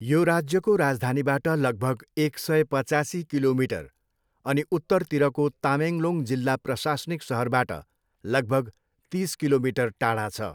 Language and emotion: Nepali, neutral